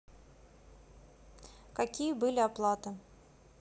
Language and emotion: Russian, neutral